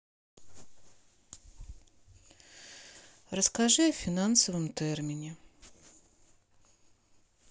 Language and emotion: Russian, sad